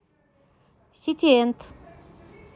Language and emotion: Russian, positive